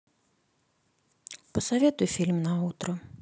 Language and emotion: Russian, neutral